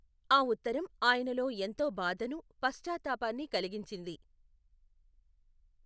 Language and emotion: Telugu, neutral